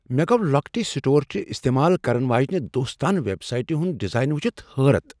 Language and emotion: Kashmiri, surprised